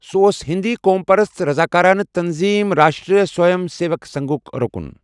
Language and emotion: Kashmiri, neutral